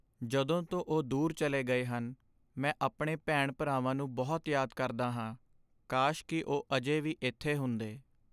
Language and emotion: Punjabi, sad